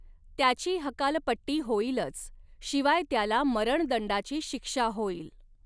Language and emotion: Marathi, neutral